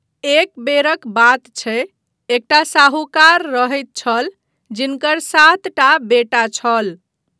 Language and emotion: Maithili, neutral